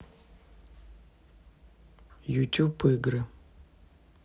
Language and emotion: Russian, neutral